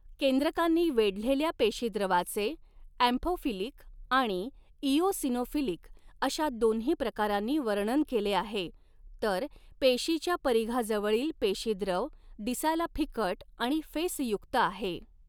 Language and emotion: Marathi, neutral